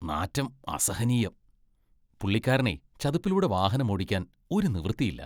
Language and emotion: Malayalam, disgusted